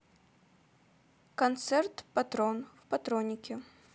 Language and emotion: Russian, neutral